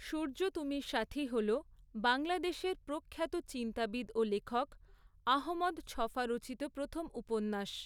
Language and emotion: Bengali, neutral